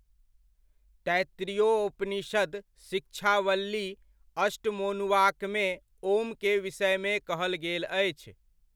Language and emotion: Maithili, neutral